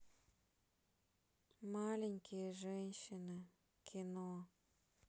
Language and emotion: Russian, sad